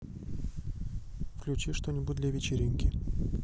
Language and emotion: Russian, neutral